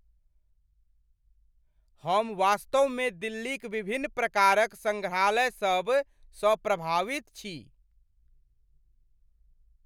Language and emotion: Maithili, surprised